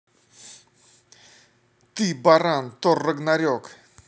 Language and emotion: Russian, angry